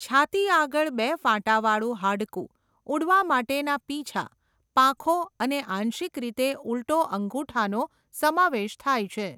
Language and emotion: Gujarati, neutral